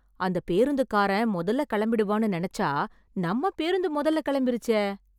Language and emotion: Tamil, surprised